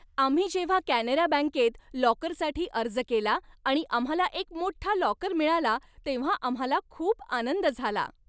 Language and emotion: Marathi, happy